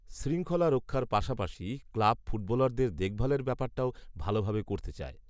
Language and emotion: Bengali, neutral